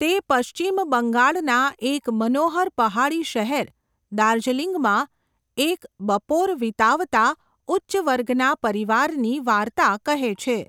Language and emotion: Gujarati, neutral